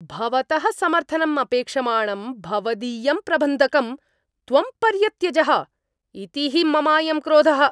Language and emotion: Sanskrit, angry